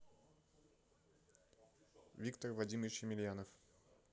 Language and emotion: Russian, neutral